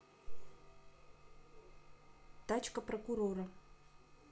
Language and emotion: Russian, neutral